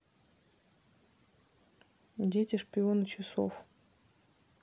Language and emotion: Russian, neutral